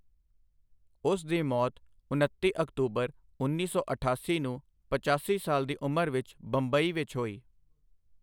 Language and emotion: Punjabi, neutral